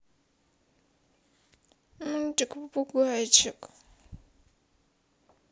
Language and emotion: Russian, sad